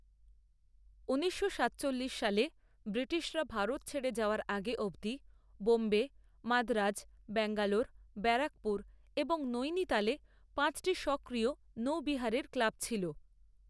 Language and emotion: Bengali, neutral